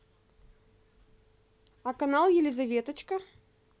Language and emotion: Russian, positive